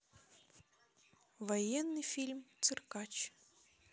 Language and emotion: Russian, neutral